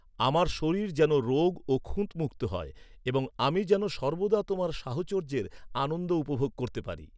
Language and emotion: Bengali, neutral